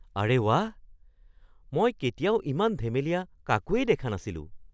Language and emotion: Assamese, surprised